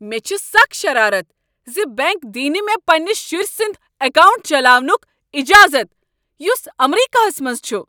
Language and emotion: Kashmiri, angry